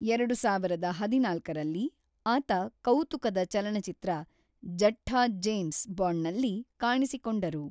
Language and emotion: Kannada, neutral